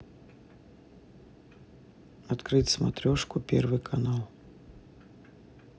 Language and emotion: Russian, neutral